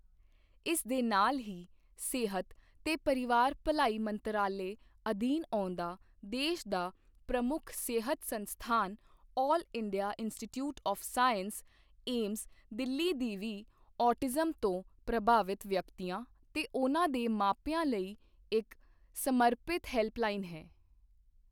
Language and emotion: Punjabi, neutral